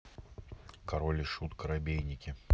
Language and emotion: Russian, neutral